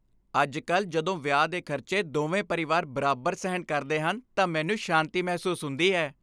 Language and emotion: Punjabi, happy